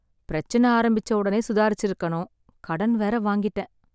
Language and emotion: Tamil, sad